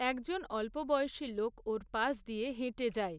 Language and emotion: Bengali, neutral